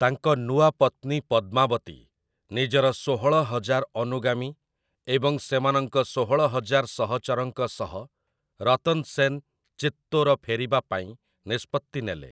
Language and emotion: Odia, neutral